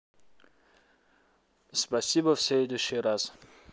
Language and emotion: Russian, neutral